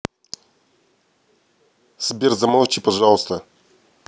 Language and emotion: Russian, neutral